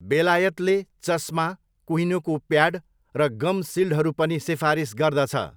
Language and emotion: Nepali, neutral